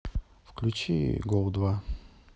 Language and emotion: Russian, neutral